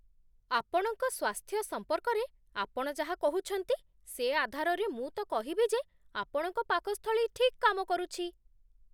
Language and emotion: Odia, surprised